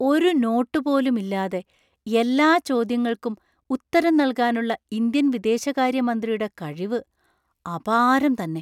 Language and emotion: Malayalam, surprised